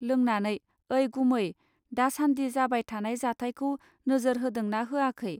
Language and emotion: Bodo, neutral